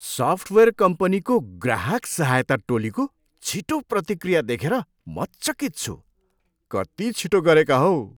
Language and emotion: Nepali, surprised